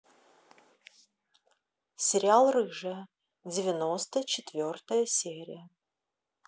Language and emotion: Russian, neutral